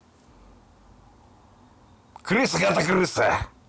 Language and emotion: Russian, angry